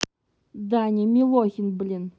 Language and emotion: Russian, angry